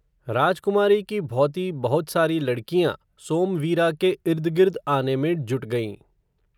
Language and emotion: Hindi, neutral